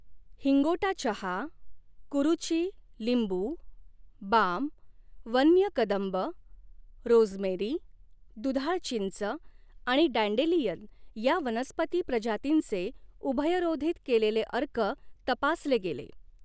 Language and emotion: Marathi, neutral